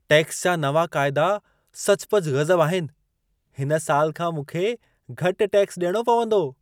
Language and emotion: Sindhi, surprised